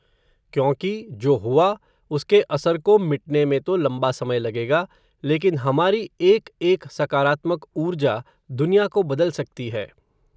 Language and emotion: Hindi, neutral